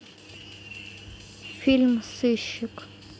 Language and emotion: Russian, neutral